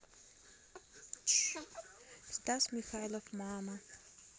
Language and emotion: Russian, neutral